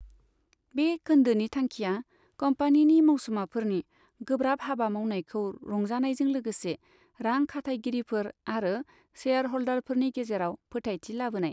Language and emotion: Bodo, neutral